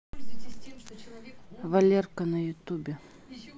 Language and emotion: Russian, neutral